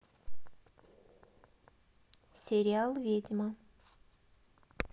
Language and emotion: Russian, neutral